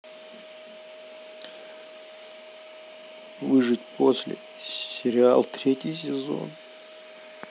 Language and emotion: Russian, sad